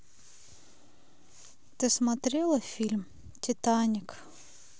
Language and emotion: Russian, sad